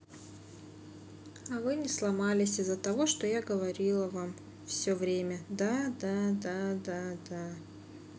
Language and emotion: Russian, neutral